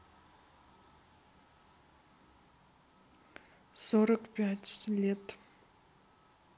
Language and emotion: Russian, sad